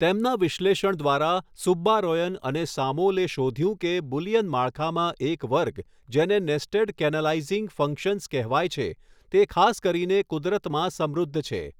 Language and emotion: Gujarati, neutral